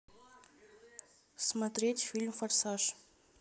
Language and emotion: Russian, neutral